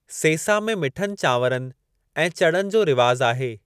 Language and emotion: Sindhi, neutral